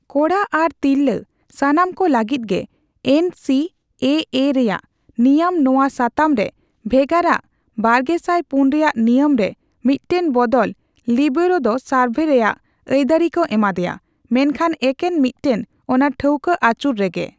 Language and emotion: Santali, neutral